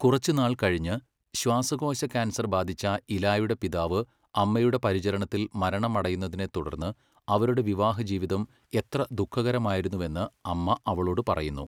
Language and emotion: Malayalam, neutral